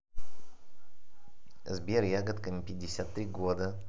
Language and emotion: Russian, neutral